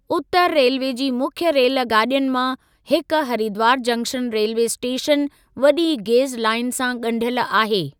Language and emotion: Sindhi, neutral